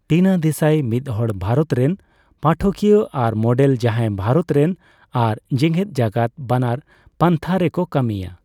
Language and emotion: Santali, neutral